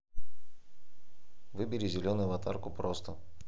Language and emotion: Russian, neutral